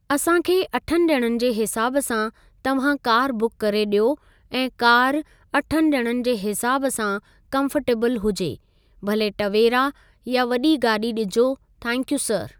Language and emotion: Sindhi, neutral